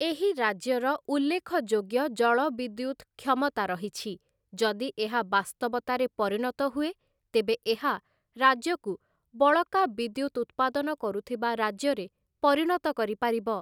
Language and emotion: Odia, neutral